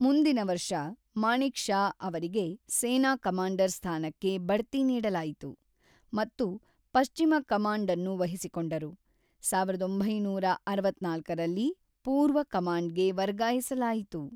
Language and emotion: Kannada, neutral